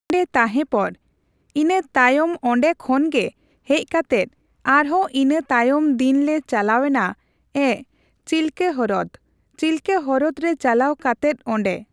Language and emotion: Santali, neutral